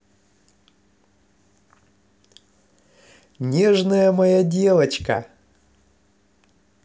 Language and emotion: Russian, positive